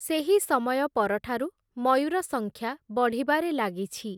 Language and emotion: Odia, neutral